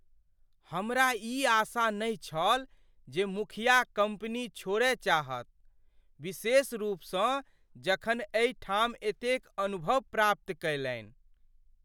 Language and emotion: Maithili, surprised